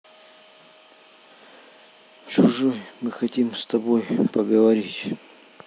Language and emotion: Russian, sad